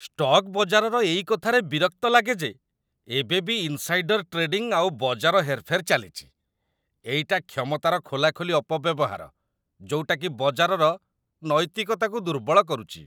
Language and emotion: Odia, disgusted